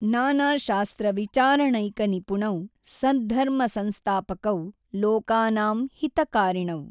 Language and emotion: Kannada, neutral